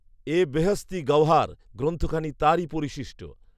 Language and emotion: Bengali, neutral